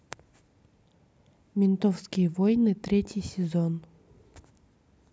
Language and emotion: Russian, neutral